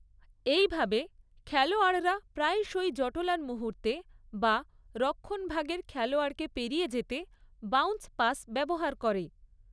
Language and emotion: Bengali, neutral